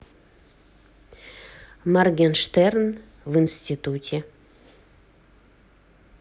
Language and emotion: Russian, neutral